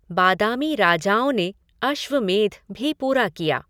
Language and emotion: Hindi, neutral